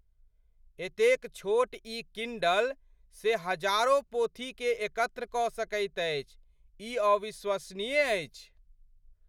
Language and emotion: Maithili, surprised